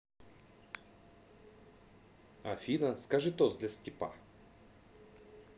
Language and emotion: Russian, positive